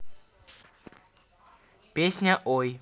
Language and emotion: Russian, neutral